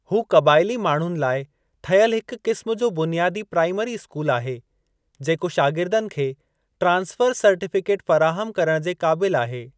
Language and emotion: Sindhi, neutral